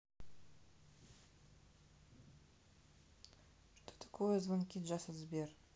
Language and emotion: Russian, neutral